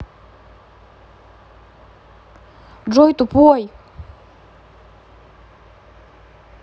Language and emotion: Russian, angry